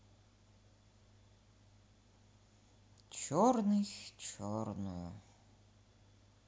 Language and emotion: Russian, sad